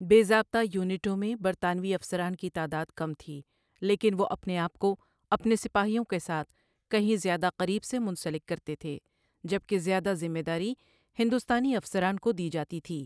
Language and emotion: Urdu, neutral